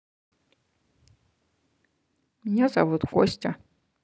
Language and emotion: Russian, neutral